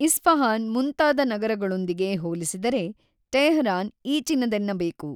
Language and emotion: Kannada, neutral